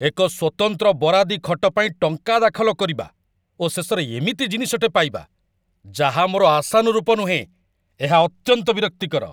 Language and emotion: Odia, angry